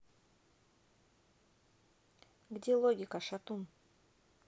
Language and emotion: Russian, neutral